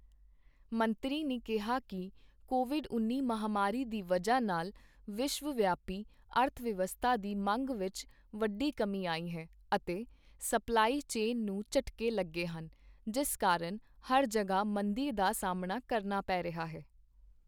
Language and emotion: Punjabi, neutral